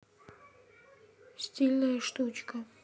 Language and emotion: Russian, neutral